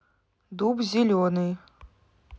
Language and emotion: Russian, neutral